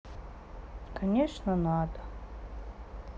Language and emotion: Russian, sad